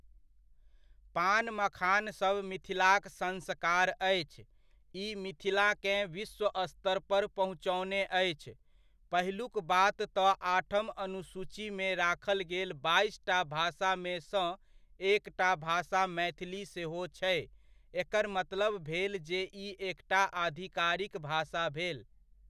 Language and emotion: Maithili, neutral